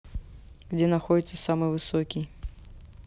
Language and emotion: Russian, neutral